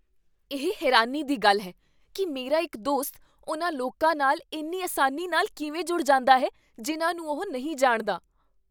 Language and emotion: Punjabi, surprised